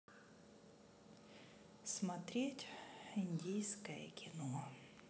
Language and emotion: Russian, sad